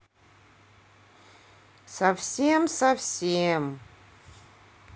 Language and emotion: Russian, sad